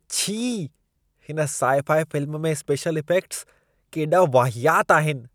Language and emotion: Sindhi, disgusted